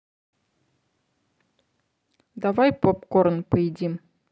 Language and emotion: Russian, neutral